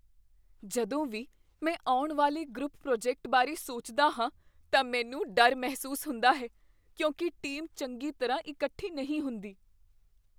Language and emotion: Punjabi, fearful